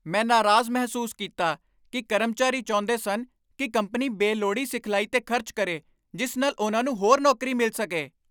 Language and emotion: Punjabi, angry